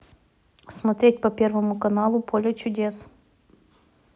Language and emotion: Russian, neutral